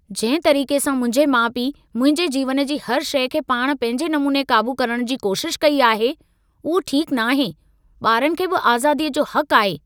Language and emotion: Sindhi, angry